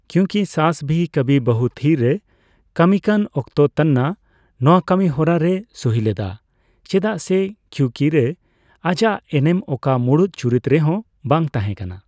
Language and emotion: Santali, neutral